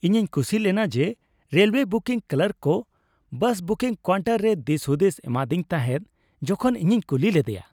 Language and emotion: Santali, happy